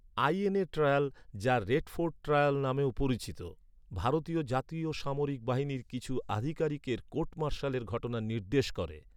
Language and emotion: Bengali, neutral